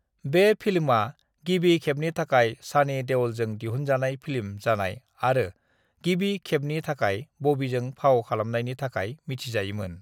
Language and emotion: Bodo, neutral